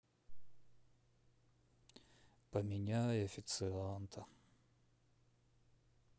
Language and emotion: Russian, sad